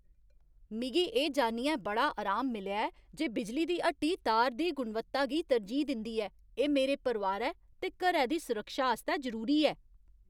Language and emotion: Dogri, happy